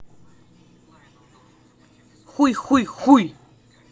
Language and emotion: Russian, angry